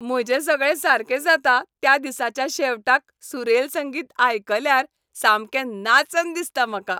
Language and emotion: Goan Konkani, happy